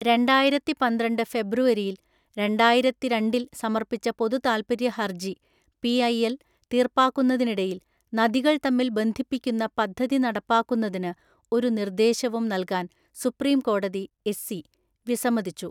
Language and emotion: Malayalam, neutral